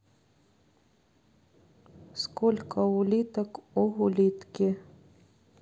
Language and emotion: Russian, neutral